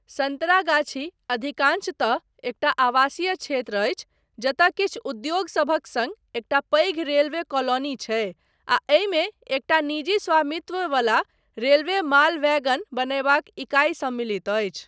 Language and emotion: Maithili, neutral